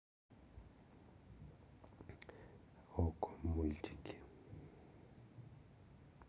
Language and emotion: Russian, neutral